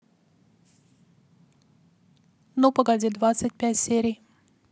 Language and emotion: Russian, neutral